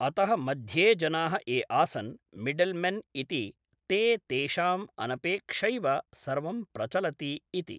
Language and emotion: Sanskrit, neutral